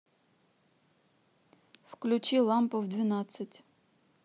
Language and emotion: Russian, neutral